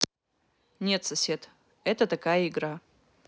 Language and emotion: Russian, neutral